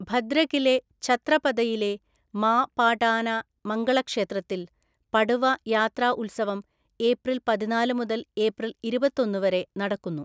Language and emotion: Malayalam, neutral